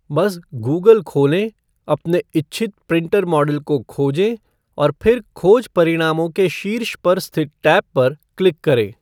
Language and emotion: Hindi, neutral